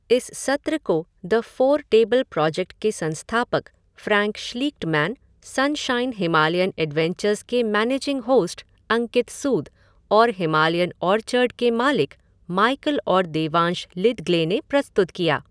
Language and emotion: Hindi, neutral